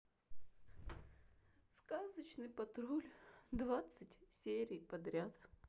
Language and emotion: Russian, sad